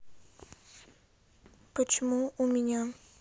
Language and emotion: Russian, sad